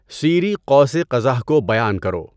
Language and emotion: Urdu, neutral